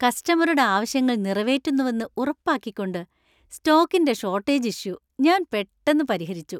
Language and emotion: Malayalam, happy